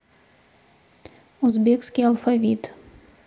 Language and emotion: Russian, neutral